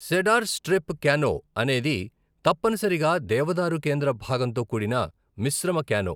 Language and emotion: Telugu, neutral